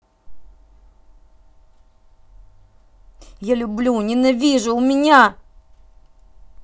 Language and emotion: Russian, angry